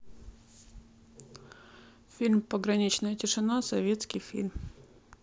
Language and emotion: Russian, neutral